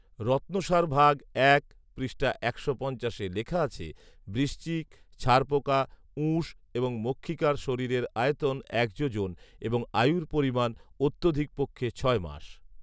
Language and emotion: Bengali, neutral